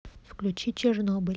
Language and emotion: Russian, neutral